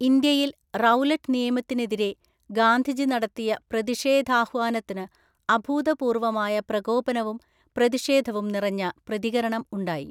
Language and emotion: Malayalam, neutral